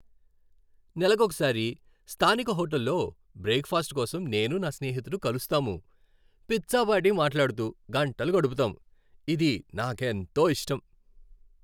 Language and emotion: Telugu, happy